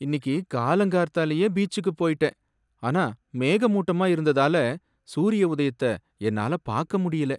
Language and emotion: Tamil, sad